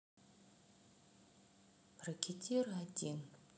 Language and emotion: Russian, sad